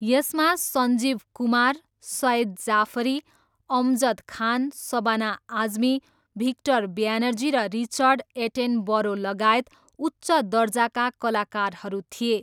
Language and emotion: Nepali, neutral